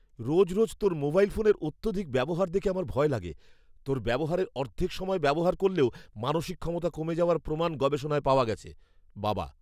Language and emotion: Bengali, fearful